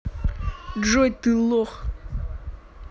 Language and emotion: Russian, angry